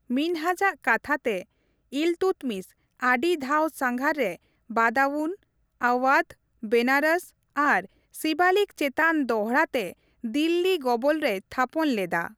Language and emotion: Santali, neutral